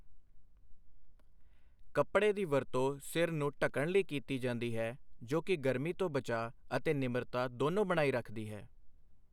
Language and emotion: Punjabi, neutral